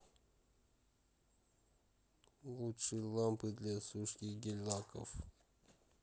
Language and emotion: Russian, sad